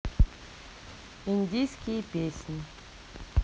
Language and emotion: Russian, neutral